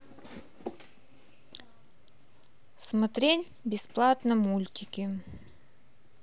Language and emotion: Russian, neutral